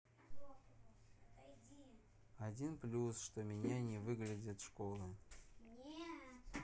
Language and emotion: Russian, sad